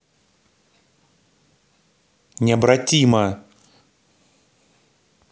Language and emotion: Russian, angry